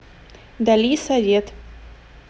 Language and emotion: Russian, neutral